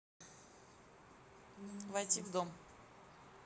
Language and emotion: Russian, neutral